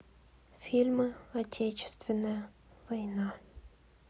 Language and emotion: Russian, sad